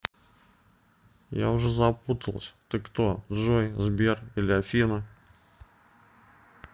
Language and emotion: Russian, neutral